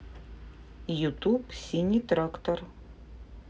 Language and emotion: Russian, neutral